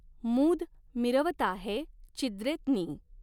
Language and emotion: Marathi, neutral